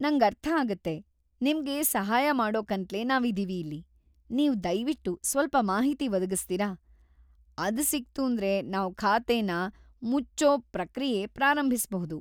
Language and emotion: Kannada, happy